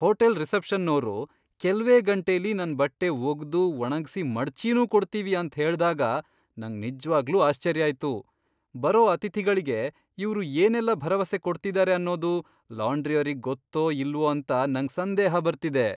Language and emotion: Kannada, surprised